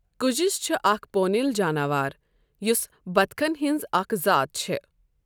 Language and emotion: Kashmiri, neutral